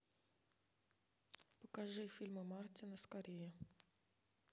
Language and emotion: Russian, neutral